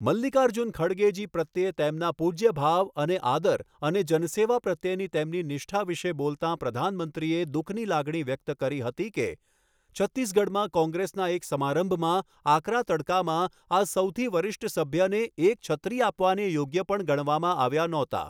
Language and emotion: Gujarati, neutral